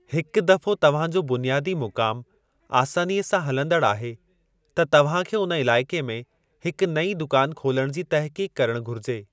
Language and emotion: Sindhi, neutral